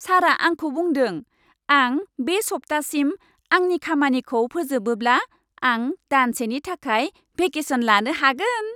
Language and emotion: Bodo, happy